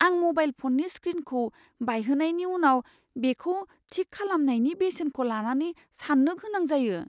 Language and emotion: Bodo, fearful